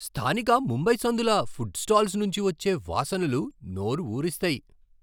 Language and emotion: Telugu, surprised